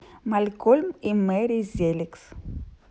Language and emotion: Russian, neutral